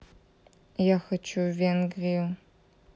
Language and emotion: Russian, neutral